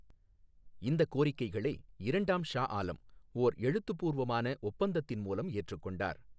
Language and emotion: Tamil, neutral